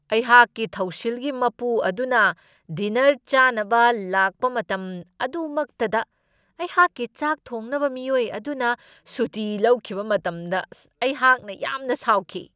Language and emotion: Manipuri, angry